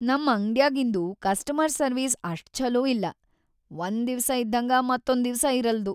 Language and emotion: Kannada, sad